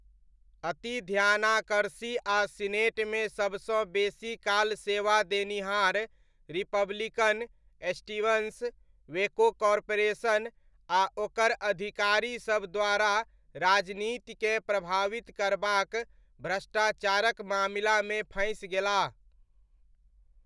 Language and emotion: Maithili, neutral